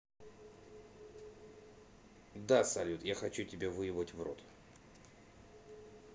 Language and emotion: Russian, neutral